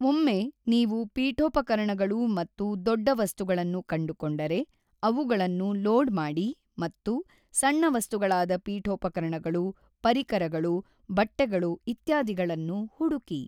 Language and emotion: Kannada, neutral